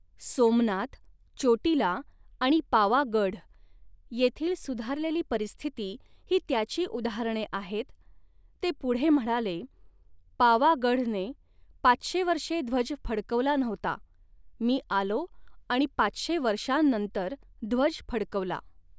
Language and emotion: Marathi, neutral